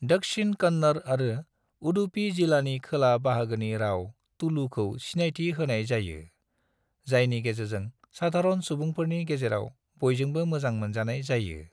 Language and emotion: Bodo, neutral